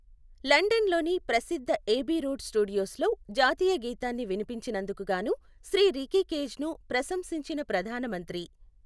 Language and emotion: Telugu, neutral